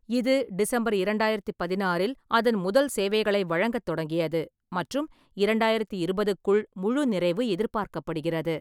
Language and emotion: Tamil, neutral